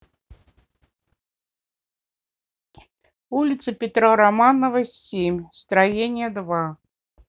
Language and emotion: Russian, neutral